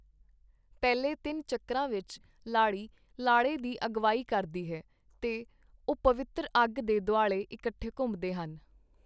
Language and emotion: Punjabi, neutral